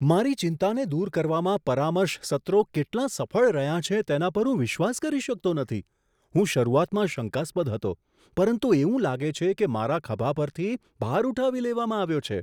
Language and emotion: Gujarati, surprised